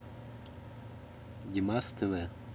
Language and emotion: Russian, neutral